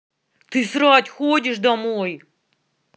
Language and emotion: Russian, angry